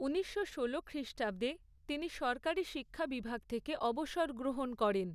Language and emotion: Bengali, neutral